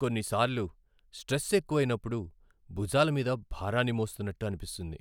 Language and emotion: Telugu, sad